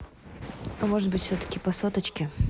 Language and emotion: Russian, neutral